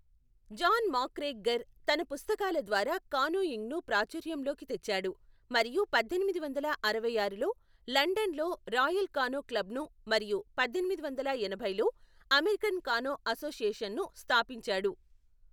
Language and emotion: Telugu, neutral